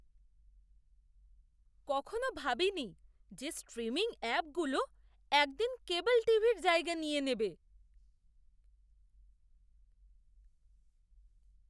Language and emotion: Bengali, surprised